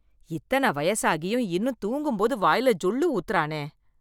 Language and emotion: Tamil, disgusted